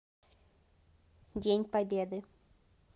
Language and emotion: Russian, neutral